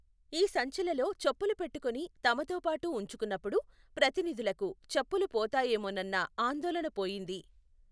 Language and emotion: Telugu, neutral